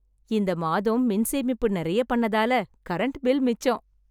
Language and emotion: Tamil, happy